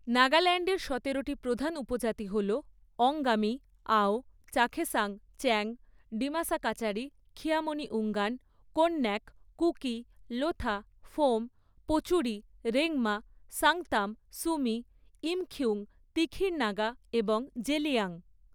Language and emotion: Bengali, neutral